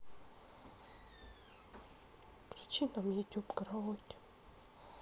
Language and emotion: Russian, sad